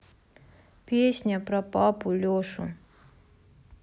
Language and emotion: Russian, sad